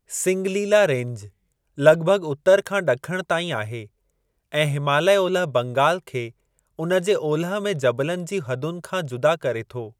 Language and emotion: Sindhi, neutral